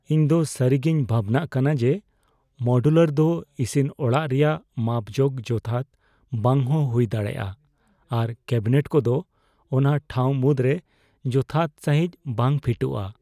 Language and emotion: Santali, fearful